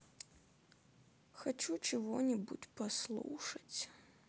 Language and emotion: Russian, sad